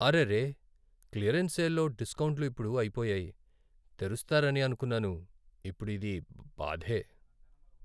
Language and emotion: Telugu, sad